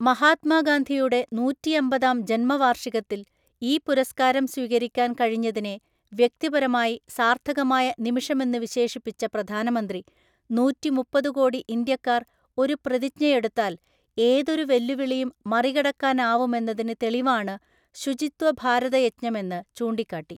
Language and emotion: Malayalam, neutral